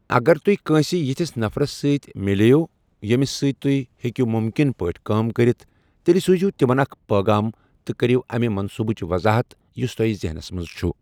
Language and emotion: Kashmiri, neutral